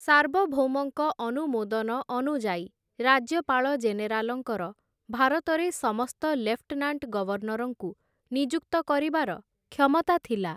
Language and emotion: Odia, neutral